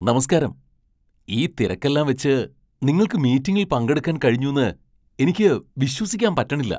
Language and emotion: Malayalam, surprised